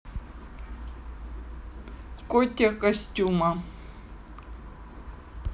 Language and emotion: Russian, neutral